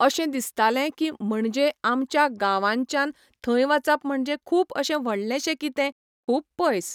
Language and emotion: Goan Konkani, neutral